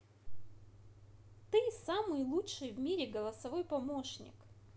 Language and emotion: Russian, positive